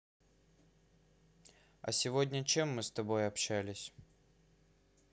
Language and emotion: Russian, neutral